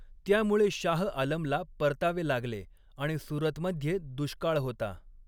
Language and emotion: Marathi, neutral